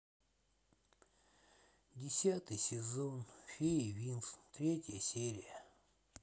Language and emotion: Russian, sad